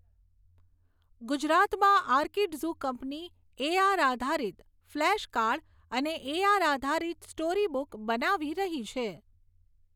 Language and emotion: Gujarati, neutral